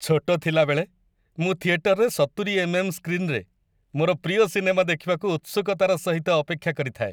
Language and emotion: Odia, happy